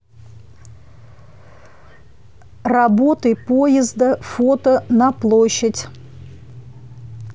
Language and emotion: Russian, neutral